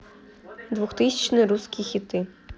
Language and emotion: Russian, neutral